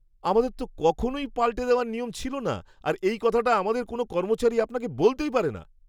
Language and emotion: Bengali, surprised